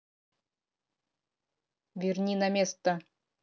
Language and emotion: Russian, angry